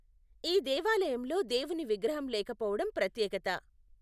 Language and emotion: Telugu, neutral